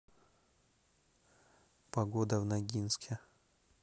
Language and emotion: Russian, neutral